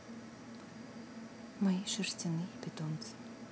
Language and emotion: Russian, neutral